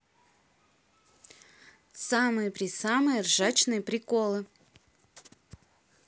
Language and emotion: Russian, neutral